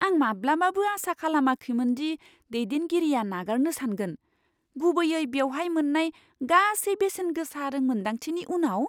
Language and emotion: Bodo, surprised